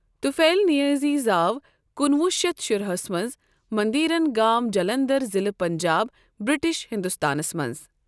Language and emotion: Kashmiri, neutral